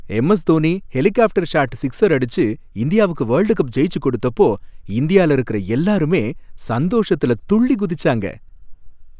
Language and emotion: Tamil, happy